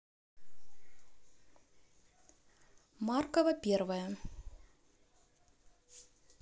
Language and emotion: Russian, neutral